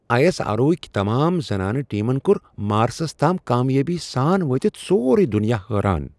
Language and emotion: Kashmiri, surprised